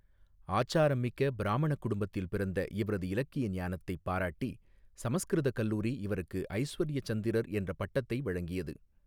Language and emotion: Tamil, neutral